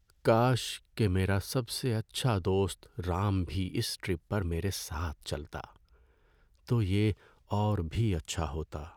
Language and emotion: Urdu, sad